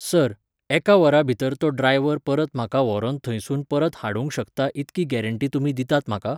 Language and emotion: Goan Konkani, neutral